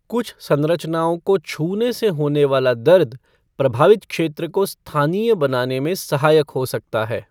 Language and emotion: Hindi, neutral